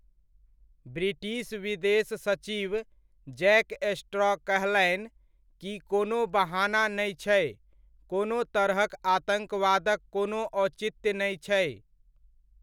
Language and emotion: Maithili, neutral